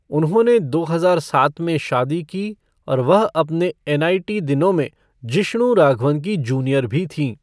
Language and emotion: Hindi, neutral